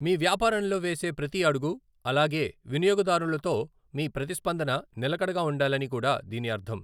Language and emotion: Telugu, neutral